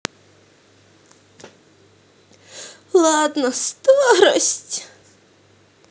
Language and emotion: Russian, sad